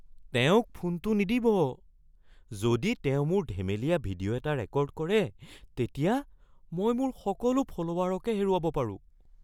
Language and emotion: Assamese, fearful